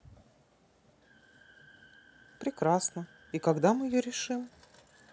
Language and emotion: Russian, neutral